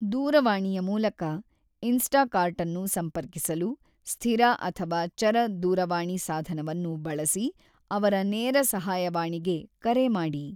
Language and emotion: Kannada, neutral